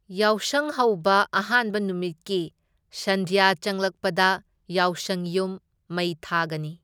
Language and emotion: Manipuri, neutral